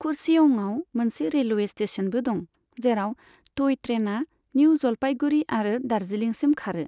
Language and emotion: Bodo, neutral